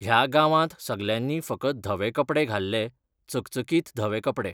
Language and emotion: Goan Konkani, neutral